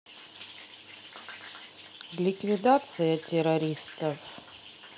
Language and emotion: Russian, neutral